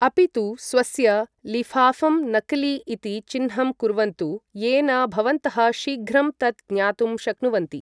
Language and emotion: Sanskrit, neutral